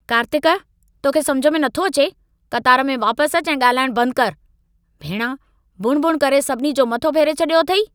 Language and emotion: Sindhi, angry